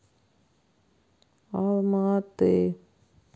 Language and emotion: Russian, sad